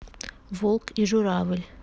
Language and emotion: Russian, neutral